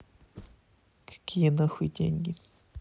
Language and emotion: Russian, neutral